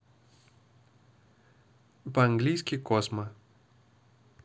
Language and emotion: Russian, neutral